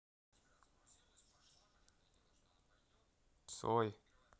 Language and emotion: Russian, neutral